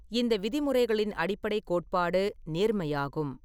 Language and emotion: Tamil, neutral